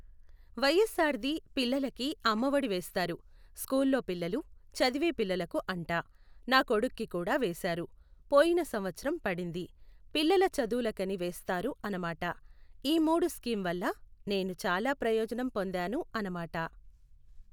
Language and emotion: Telugu, neutral